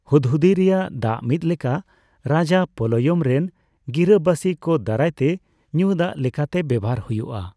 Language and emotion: Santali, neutral